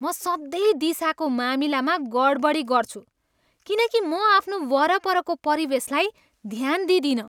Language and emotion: Nepali, disgusted